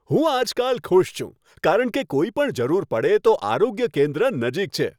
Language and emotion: Gujarati, happy